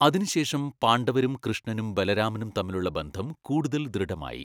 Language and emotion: Malayalam, neutral